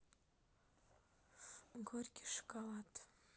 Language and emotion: Russian, sad